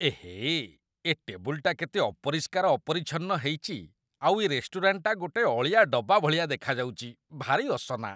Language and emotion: Odia, disgusted